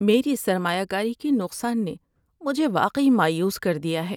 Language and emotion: Urdu, sad